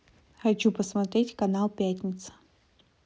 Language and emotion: Russian, neutral